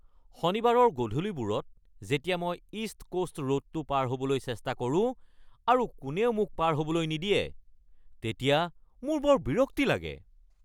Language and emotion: Assamese, angry